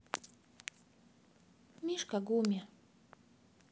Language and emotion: Russian, sad